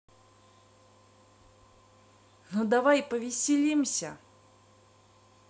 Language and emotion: Russian, positive